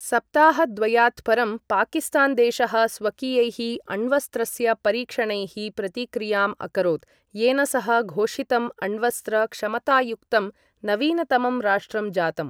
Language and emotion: Sanskrit, neutral